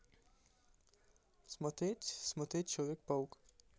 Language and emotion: Russian, neutral